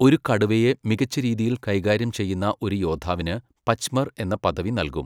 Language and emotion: Malayalam, neutral